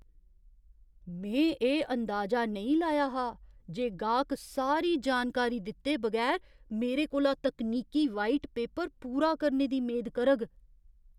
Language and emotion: Dogri, surprised